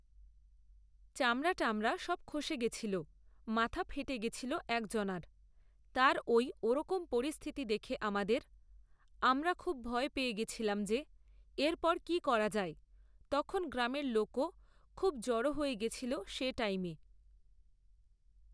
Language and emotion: Bengali, neutral